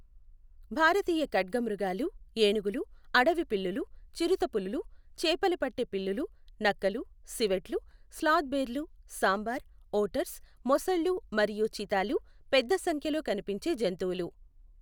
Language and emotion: Telugu, neutral